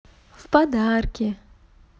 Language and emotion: Russian, positive